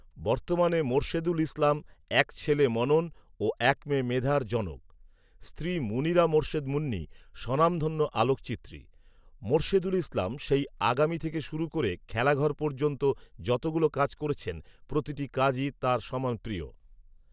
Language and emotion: Bengali, neutral